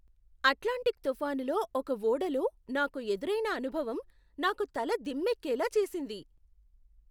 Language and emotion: Telugu, surprised